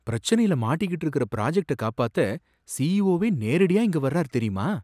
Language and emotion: Tamil, surprised